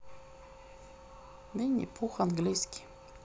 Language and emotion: Russian, neutral